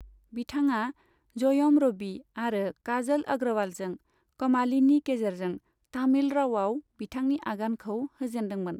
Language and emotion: Bodo, neutral